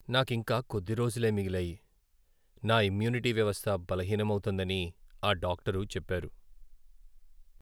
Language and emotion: Telugu, sad